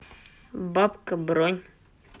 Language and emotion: Russian, neutral